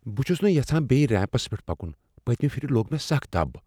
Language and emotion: Kashmiri, fearful